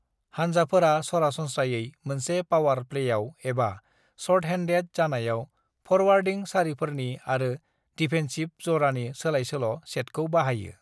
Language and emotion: Bodo, neutral